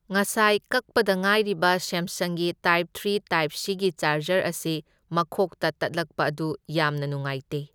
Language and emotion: Manipuri, neutral